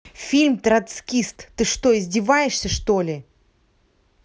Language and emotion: Russian, angry